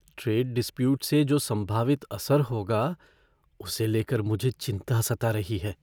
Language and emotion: Hindi, fearful